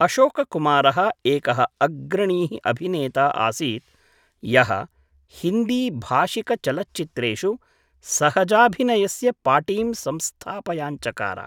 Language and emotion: Sanskrit, neutral